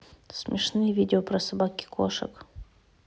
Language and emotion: Russian, neutral